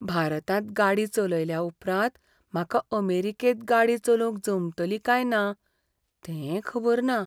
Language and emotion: Goan Konkani, fearful